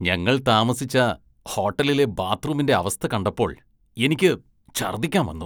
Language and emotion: Malayalam, disgusted